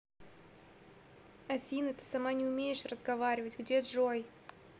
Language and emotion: Russian, neutral